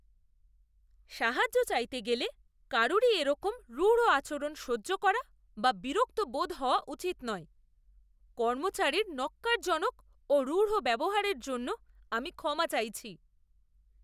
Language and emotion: Bengali, disgusted